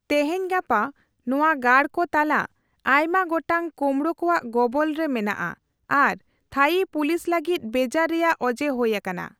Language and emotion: Santali, neutral